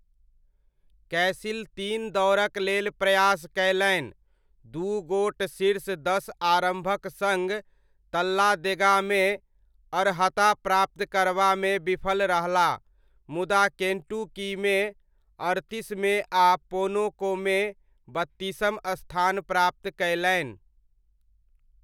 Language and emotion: Maithili, neutral